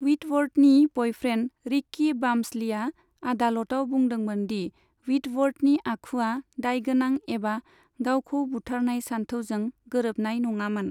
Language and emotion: Bodo, neutral